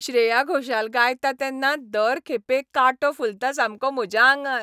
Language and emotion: Goan Konkani, happy